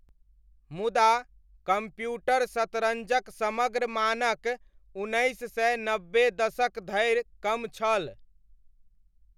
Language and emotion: Maithili, neutral